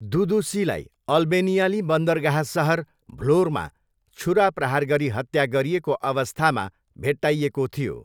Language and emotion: Nepali, neutral